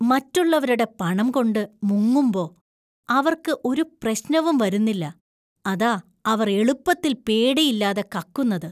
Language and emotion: Malayalam, disgusted